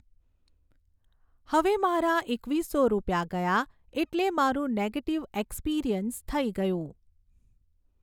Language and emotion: Gujarati, neutral